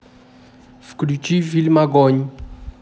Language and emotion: Russian, neutral